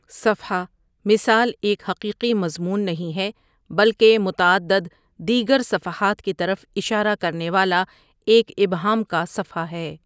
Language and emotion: Urdu, neutral